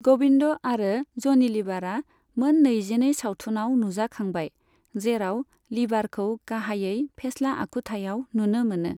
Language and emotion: Bodo, neutral